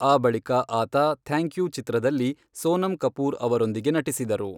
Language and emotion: Kannada, neutral